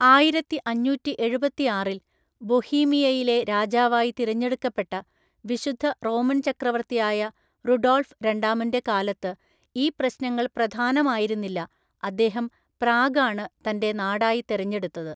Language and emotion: Malayalam, neutral